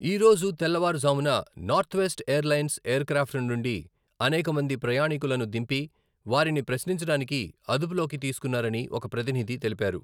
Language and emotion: Telugu, neutral